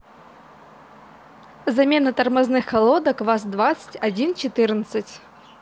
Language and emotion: Russian, neutral